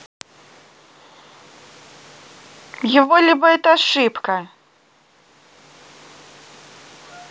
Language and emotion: Russian, neutral